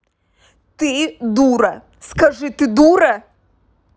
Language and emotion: Russian, angry